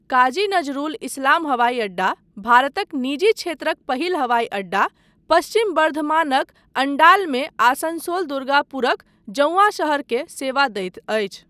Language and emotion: Maithili, neutral